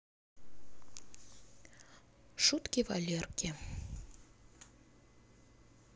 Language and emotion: Russian, sad